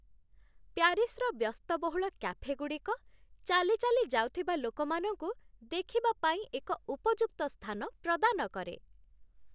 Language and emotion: Odia, happy